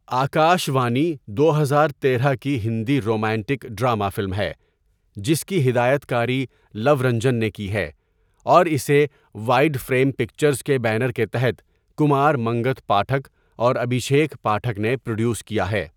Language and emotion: Urdu, neutral